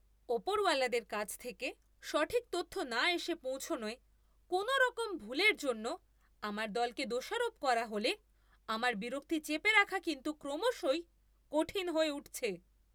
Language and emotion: Bengali, angry